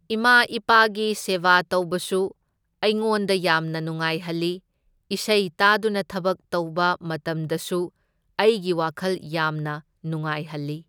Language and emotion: Manipuri, neutral